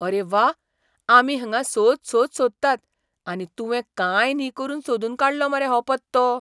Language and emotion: Goan Konkani, surprised